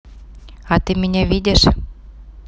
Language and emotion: Russian, neutral